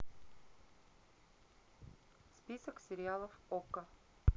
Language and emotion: Russian, neutral